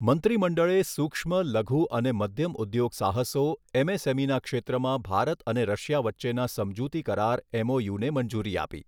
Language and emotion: Gujarati, neutral